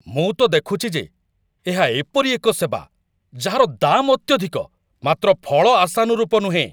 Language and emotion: Odia, angry